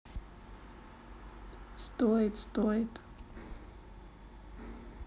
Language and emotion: Russian, sad